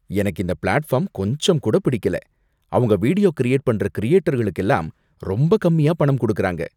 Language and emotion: Tamil, disgusted